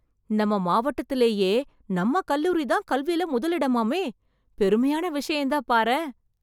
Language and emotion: Tamil, surprised